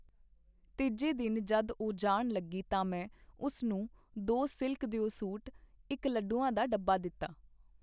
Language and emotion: Punjabi, neutral